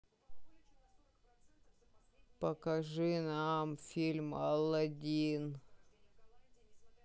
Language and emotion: Russian, sad